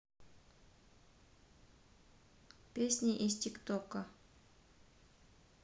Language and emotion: Russian, neutral